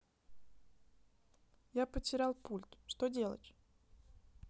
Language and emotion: Russian, neutral